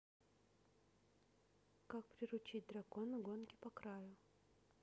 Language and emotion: Russian, neutral